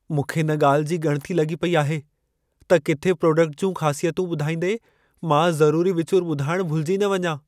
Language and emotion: Sindhi, fearful